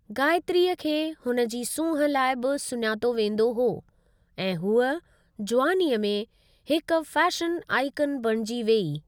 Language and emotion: Sindhi, neutral